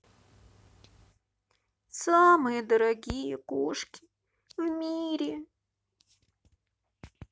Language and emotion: Russian, sad